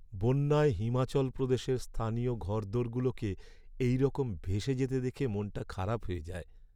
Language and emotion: Bengali, sad